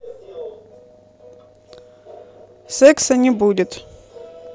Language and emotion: Russian, neutral